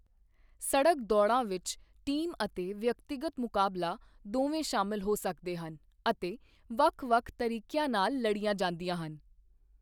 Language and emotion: Punjabi, neutral